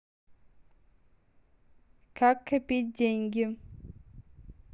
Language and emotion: Russian, neutral